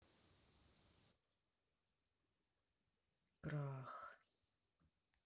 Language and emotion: Russian, sad